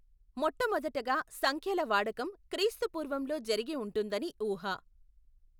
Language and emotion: Telugu, neutral